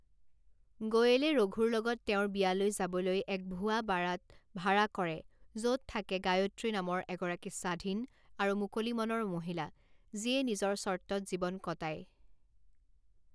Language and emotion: Assamese, neutral